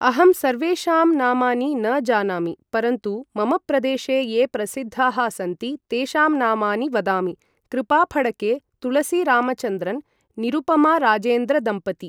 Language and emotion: Sanskrit, neutral